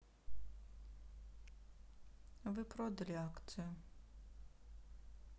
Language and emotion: Russian, sad